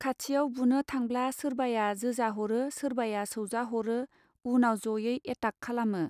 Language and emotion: Bodo, neutral